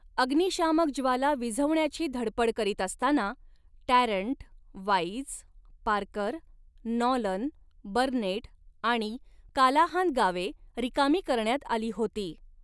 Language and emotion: Marathi, neutral